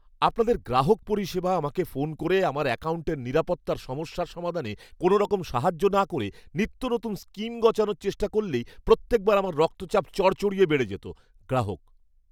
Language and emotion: Bengali, angry